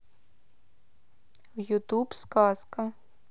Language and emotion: Russian, neutral